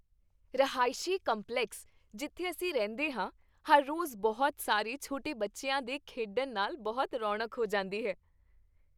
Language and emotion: Punjabi, happy